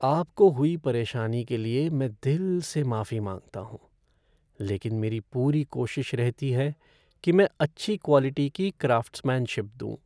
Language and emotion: Hindi, sad